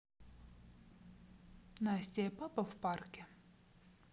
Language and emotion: Russian, neutral